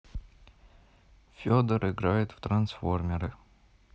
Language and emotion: Russian, neutral